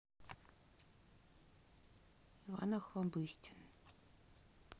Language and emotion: Russian, neutral